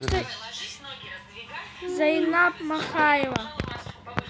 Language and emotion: Russian, neutral